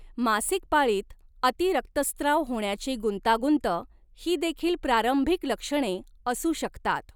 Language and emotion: Marathi, neutral